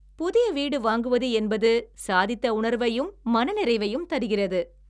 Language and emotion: Tamil, happy